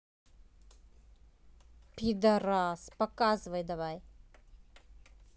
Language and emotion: Russian, angry